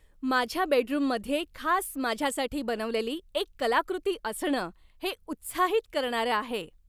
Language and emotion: Marathi, happy